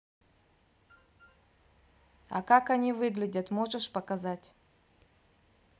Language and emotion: Russian, neutral